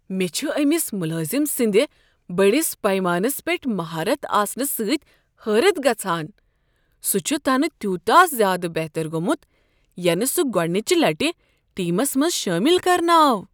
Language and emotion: Kashmiri, surprised